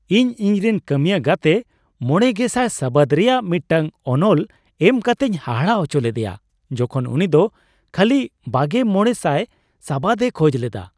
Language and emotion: Santali, surprised